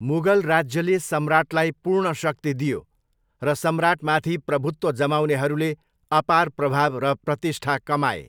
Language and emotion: Nepali, neutral